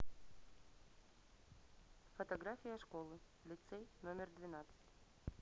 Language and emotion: Russian, neutral